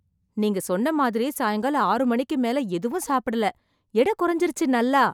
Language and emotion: Tamil, surprised